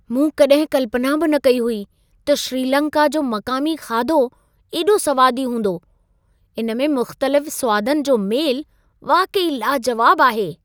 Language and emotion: Sindhi, surprised